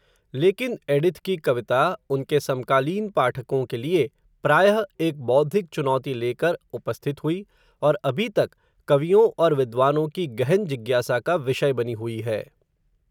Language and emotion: Hindi, neutral